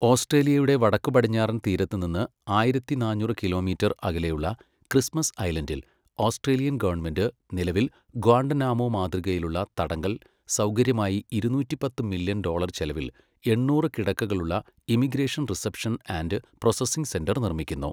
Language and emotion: Malayalam, neutral